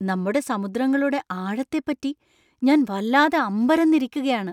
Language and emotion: Malayalam, surprised